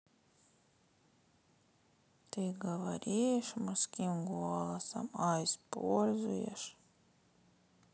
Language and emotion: Russian, sad